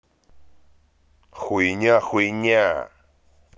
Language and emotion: Russian, angry